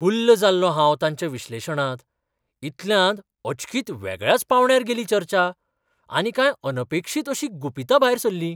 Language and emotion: Goan Konkani, surprised